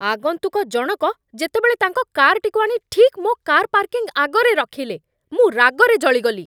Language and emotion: Odia, angry